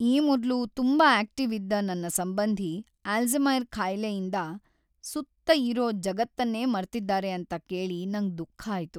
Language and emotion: Kannada, sad